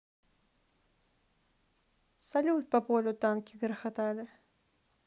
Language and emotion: Russian, neutral